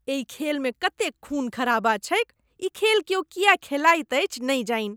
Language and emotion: Maithili, disgusted